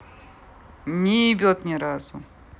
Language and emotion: Russian, neutral